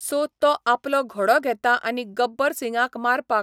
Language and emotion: Goan Konkani, neutral